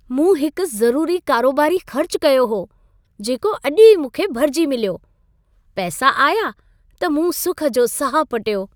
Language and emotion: Sindhi, happy